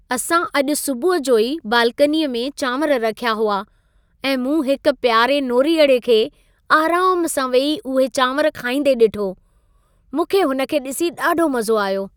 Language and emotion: Sindhi, happy